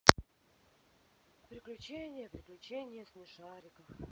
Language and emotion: Russian, sad